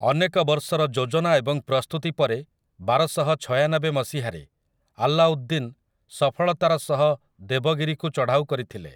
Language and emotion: Odia, neutral